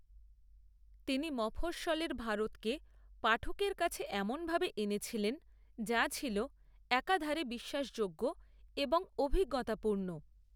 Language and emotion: Bengali, neutral